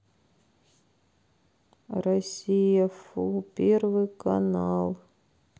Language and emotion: Russian, sad